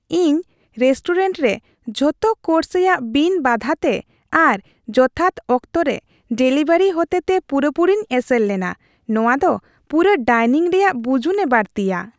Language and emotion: Santali, happy